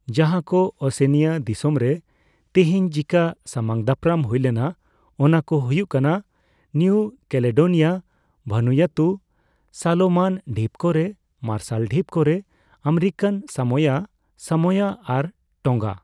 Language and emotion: Santali, neutral